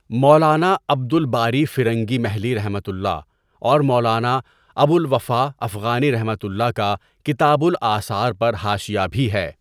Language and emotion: Urdu, neutral